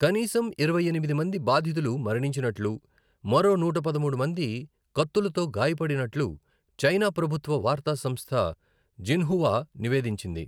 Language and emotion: Telugu, neutral